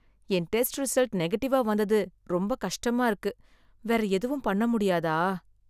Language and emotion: Tamil, sad